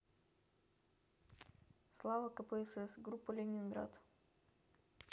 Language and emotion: Russian, neutral